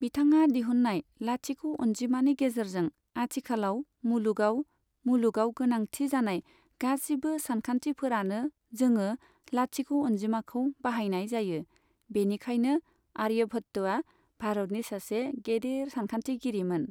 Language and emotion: Bodo, neutral